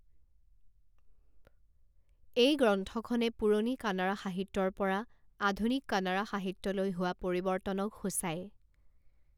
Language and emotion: Assamese, neutral